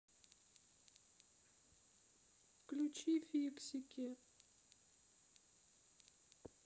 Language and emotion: Russian, sad